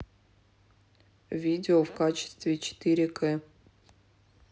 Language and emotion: Russian, neutral